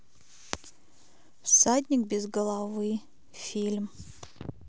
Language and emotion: Russian, neutral